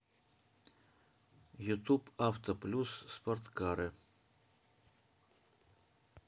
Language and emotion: Russian, neutral